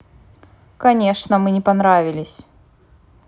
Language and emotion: Russian, angry